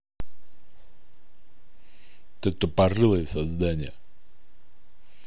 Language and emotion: Russian, angry